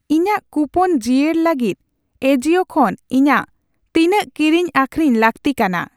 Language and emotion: Santali, neutral